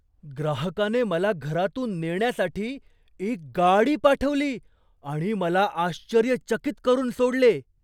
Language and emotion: Marathi, surprised